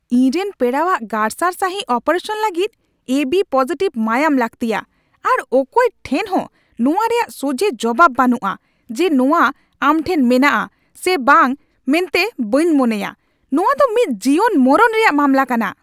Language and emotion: Santali, angry